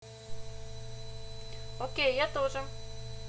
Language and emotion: Russian, positive